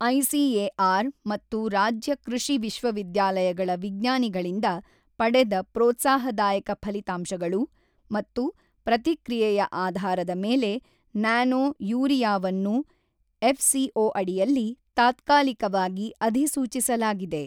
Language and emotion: Kannada, neutral